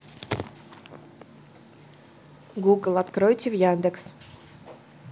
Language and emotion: Russian, neutral